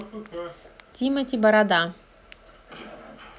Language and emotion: Russian, neutral